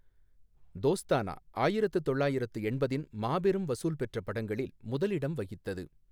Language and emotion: Tamil, neutral